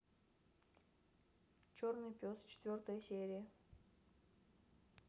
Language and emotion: Russian, neutral